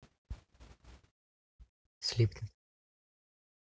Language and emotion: Russian, neutral